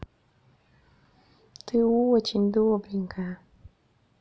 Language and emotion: Russian, positive